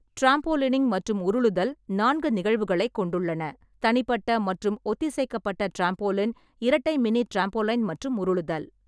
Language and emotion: Tamil, neutral